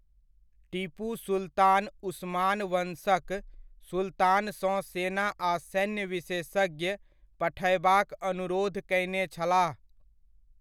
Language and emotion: Maithili, neutral